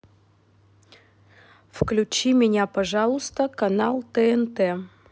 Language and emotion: Russian, neutral